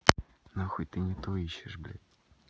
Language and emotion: Russian, neutral